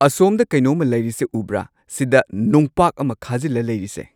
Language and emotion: Manipuri, neutral